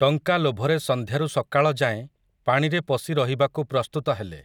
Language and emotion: Odia, neutral